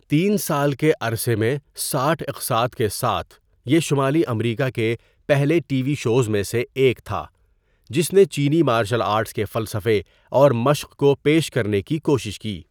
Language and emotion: Urdu, neutral